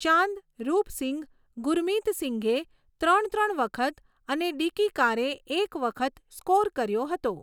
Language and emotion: Gujarati, neutral